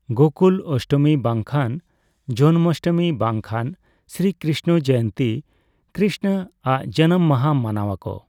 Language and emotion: Santali, neutral